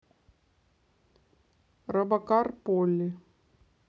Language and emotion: Russian, neutral